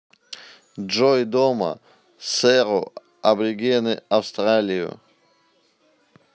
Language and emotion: Russian, neutral